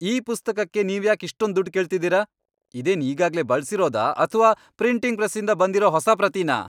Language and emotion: Kannada, angry